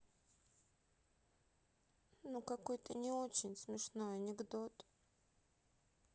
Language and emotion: Russian, sad